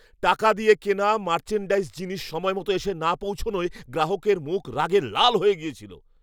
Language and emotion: Bengali, angry